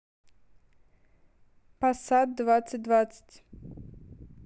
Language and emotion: Russian, neutral